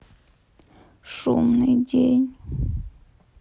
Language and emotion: Russian, sad